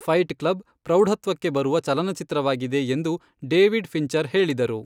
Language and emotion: Kannada, neutral